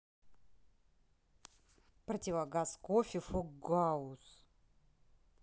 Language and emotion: Russian, neutral